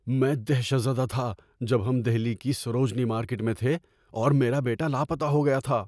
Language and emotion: Urdu, fearful